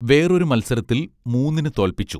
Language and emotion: Malayalam, neutral